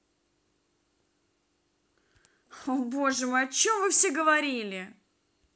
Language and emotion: Russian, angry